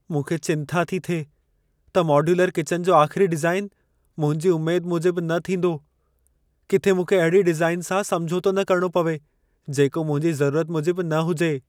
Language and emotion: Sindhi, fearful